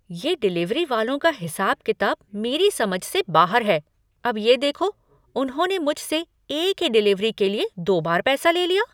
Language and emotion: Hindi, surprised